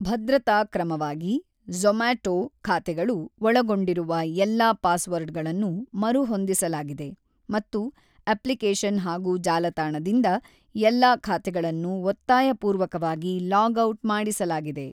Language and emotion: Kannada, neutral